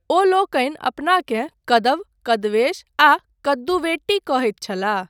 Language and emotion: Maithili, neutral